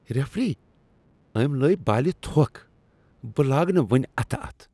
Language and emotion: Kashmiri, disgusted